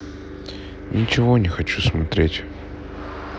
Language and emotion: Russian, sad